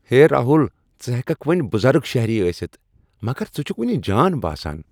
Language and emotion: Kashmiri, happy